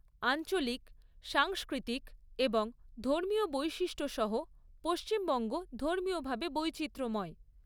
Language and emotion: Bengali, neutral